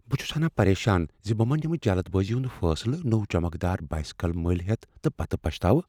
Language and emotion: Kashmiri, fearful